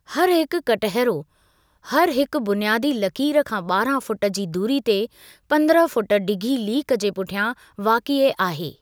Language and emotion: Sindhi, neutral